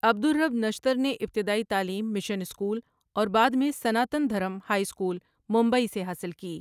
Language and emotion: Urdu, neutral